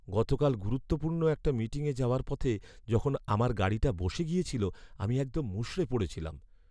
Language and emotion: Bengali, sad